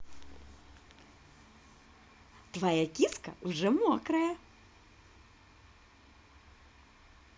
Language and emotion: Russian, positive